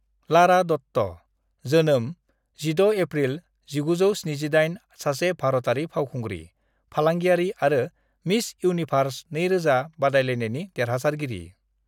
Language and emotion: Bodo, neutral